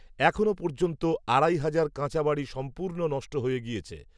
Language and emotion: Bengali, neutral